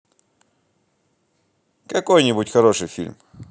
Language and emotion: Russian, positive